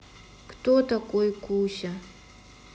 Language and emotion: Russian, sad